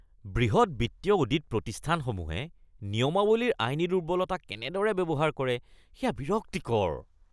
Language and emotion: Assamese, disgusted